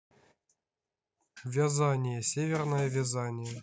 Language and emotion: Russian, neutral